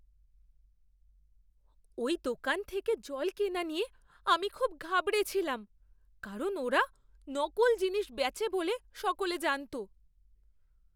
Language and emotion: Bengali, fearful